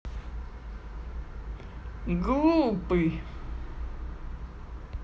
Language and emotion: Russian, positive